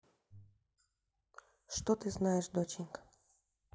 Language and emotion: Russian, neutral